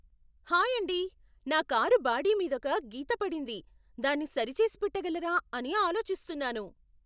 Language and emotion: Telugu, surprised